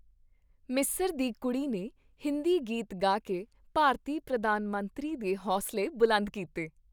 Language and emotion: Punjabi, happy